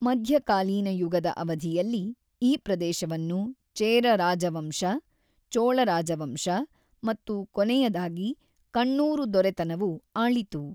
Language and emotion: Kannada, neutral